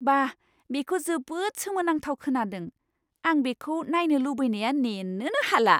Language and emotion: Bodo, surprised